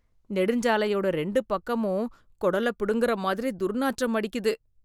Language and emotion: Tamil, disgusted